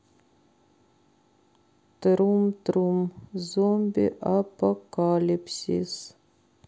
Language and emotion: Russian, sad